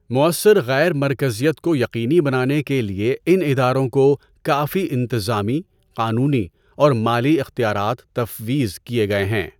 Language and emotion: Urdu, neutral